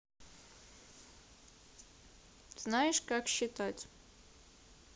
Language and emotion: Russian, neutral